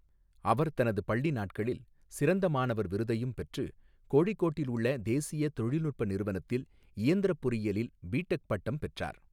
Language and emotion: Tamil, neutral